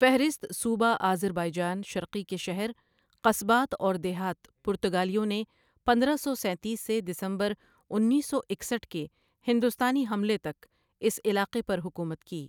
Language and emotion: Urdu, neutral